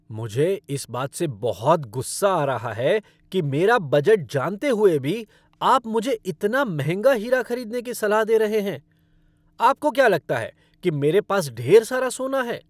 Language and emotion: Hindi, angry